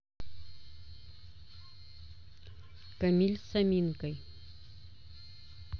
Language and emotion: Russian, neutral